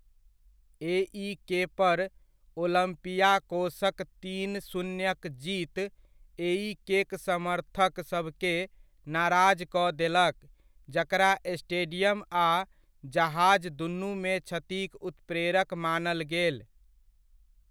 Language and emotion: Maithili, neutral